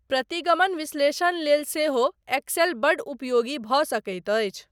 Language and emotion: Maithili, neutral